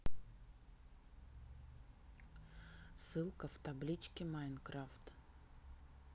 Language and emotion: Russian, neutral